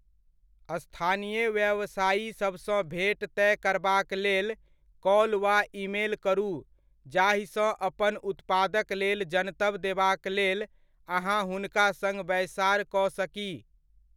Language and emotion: Maithili, neutral